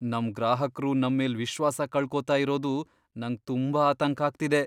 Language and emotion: Kannada, fearful